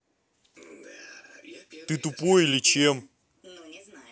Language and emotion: Russian, angry